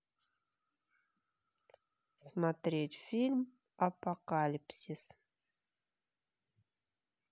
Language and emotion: Russian, neutral